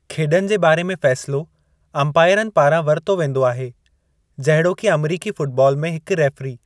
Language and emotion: Sindhi, neutral